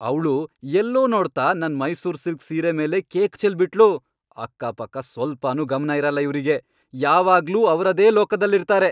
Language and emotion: Kannada, angry